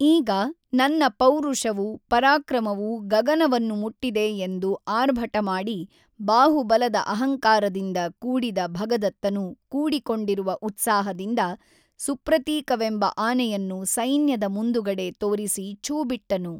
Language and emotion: Kannada, neutral